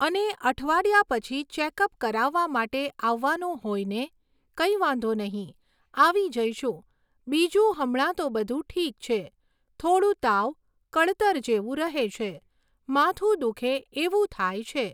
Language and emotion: Gujarati, neutral